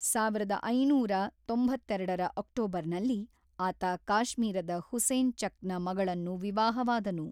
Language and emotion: Kannada, neutral